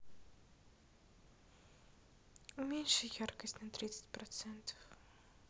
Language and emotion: Russian, sad